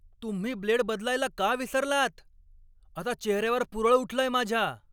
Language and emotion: Marathi, angry